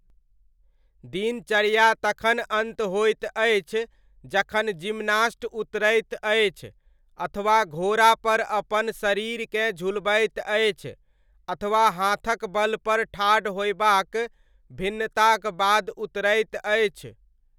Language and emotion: Maithili, neutral